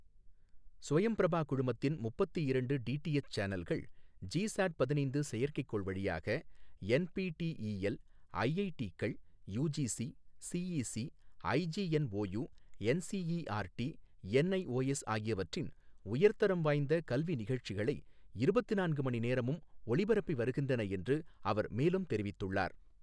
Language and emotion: Tamil, neutral